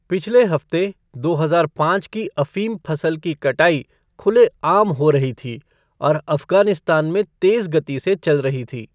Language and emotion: Hindi, neutral